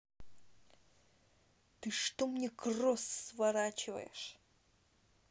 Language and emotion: Russian, angry